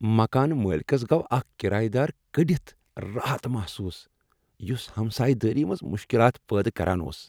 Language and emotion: Kashmiri, happy